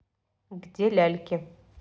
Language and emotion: Russian, neutral